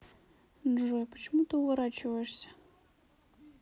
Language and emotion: Russian, sad